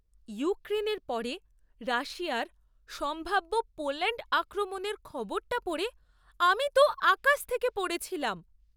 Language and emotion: Bengali, surprised